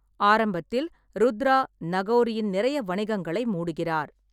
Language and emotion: Tamil, neutral